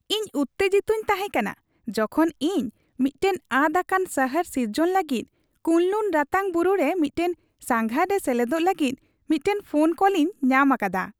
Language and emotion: Santali, happy